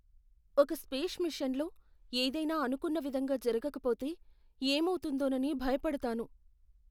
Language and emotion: Telugu, fearful